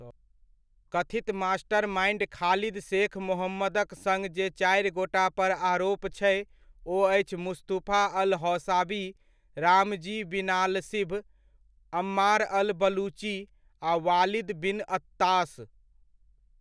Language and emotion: Maithili, neutral